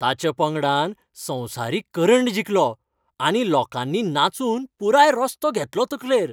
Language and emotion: Goan Konkani, happy